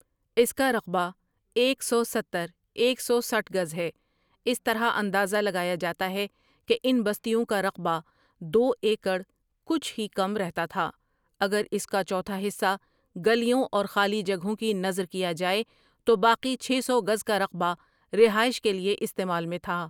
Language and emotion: Urdu, neutral